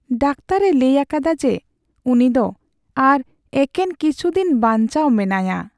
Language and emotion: Santali, sad